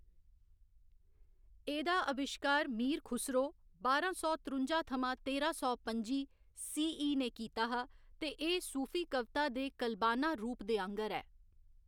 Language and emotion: Dogri, neutral